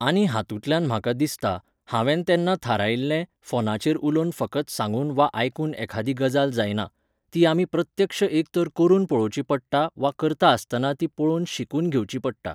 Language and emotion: Goan Konkani, neutral